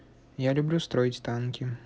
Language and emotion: Russian, neutral